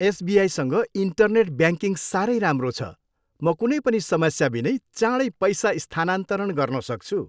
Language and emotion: Nepali, happy